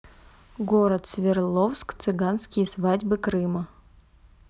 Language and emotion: Russian, neutral